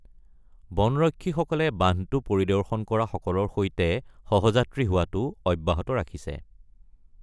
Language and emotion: Assamese, neutral